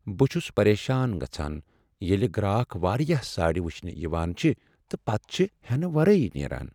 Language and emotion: Kashmiri, sad